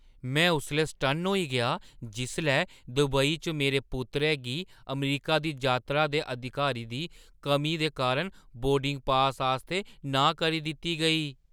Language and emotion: Dogri, surprised